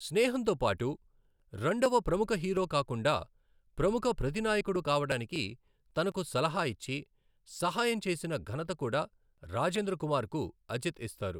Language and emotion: Telugu, neutral